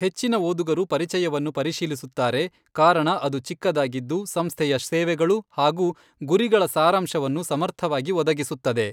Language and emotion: Kannada, neutral